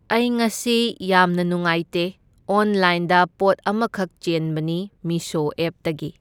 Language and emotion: Manipuri, neutral